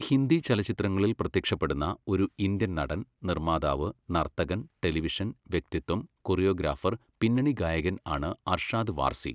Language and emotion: Malayalam, neutral